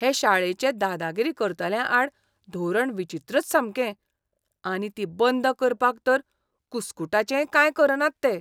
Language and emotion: Goan Konkani, disgusted